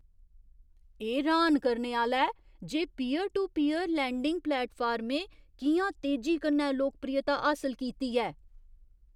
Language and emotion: Dogri, surprised